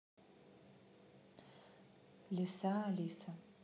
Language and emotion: Russian, neutral